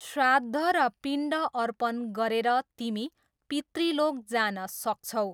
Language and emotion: Nepali, neutral